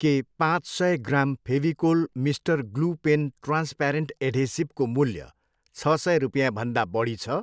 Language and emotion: Nepali, neutral